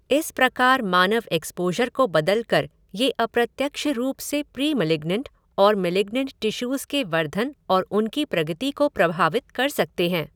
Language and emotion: Hindi, neutral